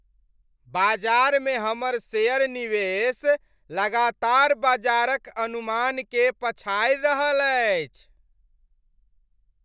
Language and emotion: Maithili, happy